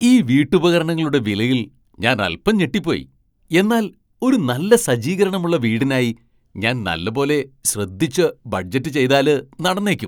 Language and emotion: Malayalam, surprised